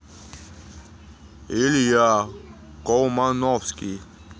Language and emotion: Russian, neutral